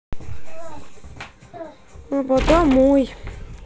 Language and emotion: Russian, sad